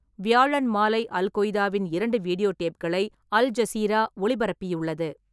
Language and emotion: Tamil, neutral